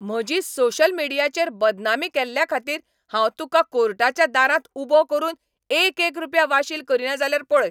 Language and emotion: Goan Konkani, angry